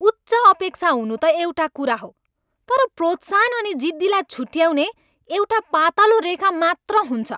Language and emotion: Nepali, angry